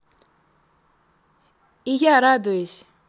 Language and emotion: Russian, positive